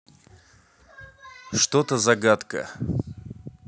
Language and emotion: Russian, neutral